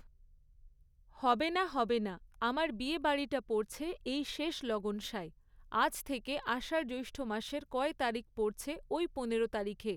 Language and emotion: Bengali, neutral